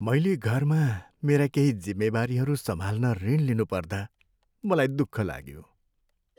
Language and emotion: Nepali, sad